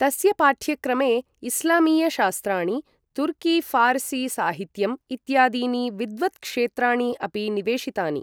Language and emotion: Sanskrit, neutral